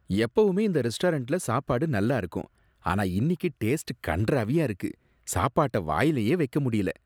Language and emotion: Tamil, disgusted